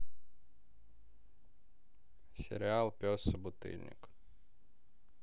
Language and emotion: Russian, neutral